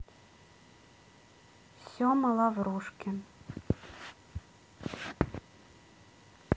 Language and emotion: Russian, neutral